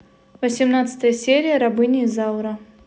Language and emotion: Russian, neutral